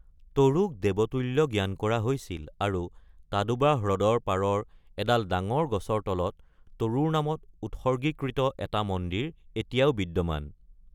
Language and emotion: Assamese, neutral